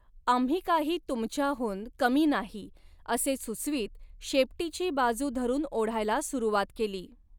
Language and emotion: Marathi, neutral